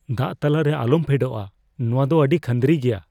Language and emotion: Santali, fearful